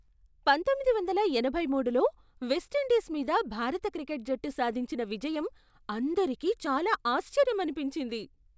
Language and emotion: Telugu, surprised